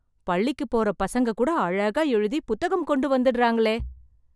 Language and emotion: Tamil, surprised